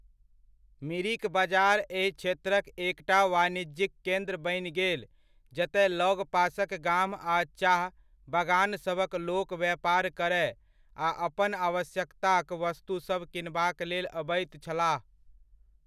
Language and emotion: Maithili, neutral